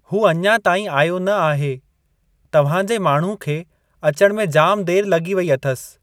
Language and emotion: Sindhi, neutral